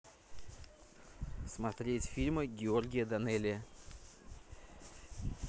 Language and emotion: Russian, neutral